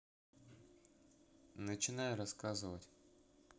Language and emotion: Russian, neutral